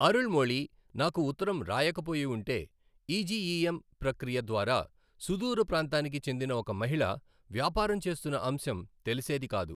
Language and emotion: Telugu, neutral